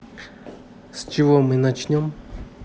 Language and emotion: Russian, neutral